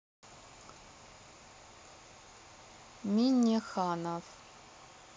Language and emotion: Russian, neutral